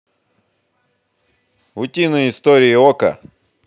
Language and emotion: Russian, positive